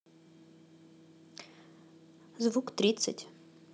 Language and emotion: Russian, neutral